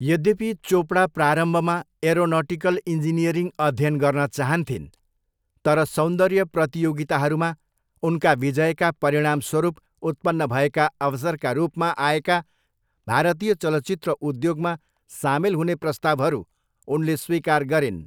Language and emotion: Nepali, neutral